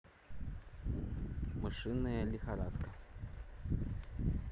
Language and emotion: Russian, neutral